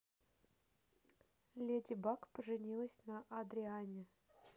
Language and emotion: Russian, neutral